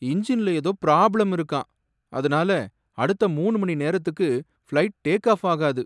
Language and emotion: Tamil, sad